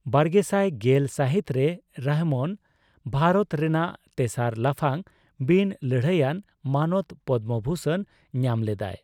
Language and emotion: Santali, neutral